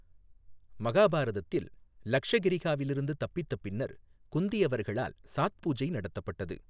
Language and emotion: Tamil, neutral